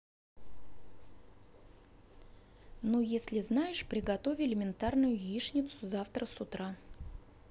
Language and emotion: Russian, neutral